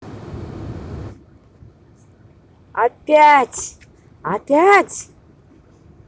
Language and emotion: Russian, angry